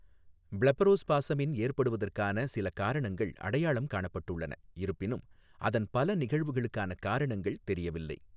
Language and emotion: Tamil, neutral